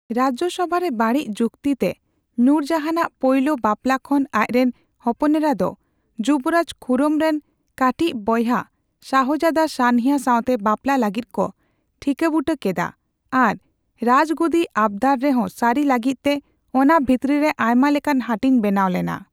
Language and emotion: Santali, neutral